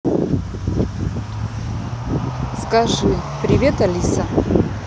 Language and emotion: Russian, neutral